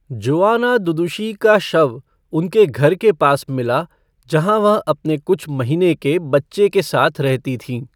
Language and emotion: Hindi, neutral